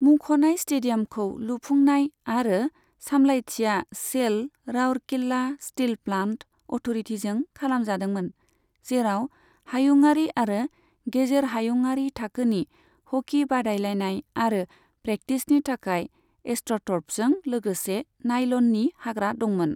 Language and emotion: Bodo, neutral